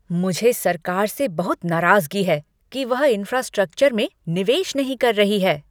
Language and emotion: Hindi, angry